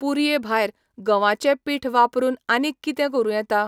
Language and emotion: Goan Konkani, neutral